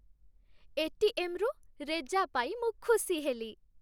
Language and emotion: Odia, happy